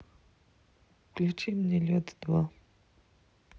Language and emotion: Russian, neutral